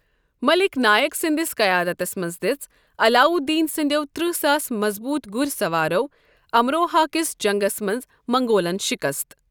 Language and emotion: Kashmiri, neutral